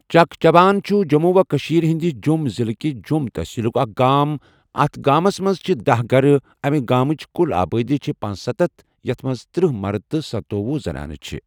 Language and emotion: Kashmiri, neutral